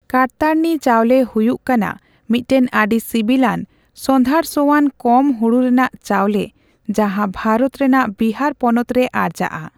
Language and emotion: Santali, neutral